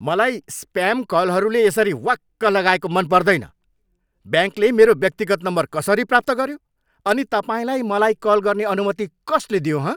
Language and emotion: Nepali, angry